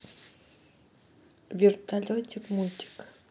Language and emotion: Russian, neutral